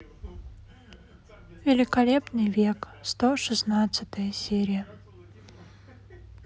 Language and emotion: Russian, sad